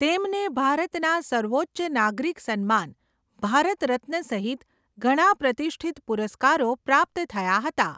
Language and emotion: Gujarati, neutral